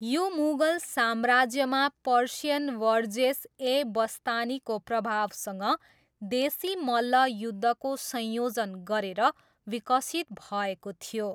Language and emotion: Nepali, neutral